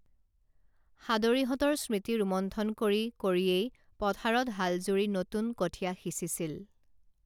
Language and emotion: Assamese, neutral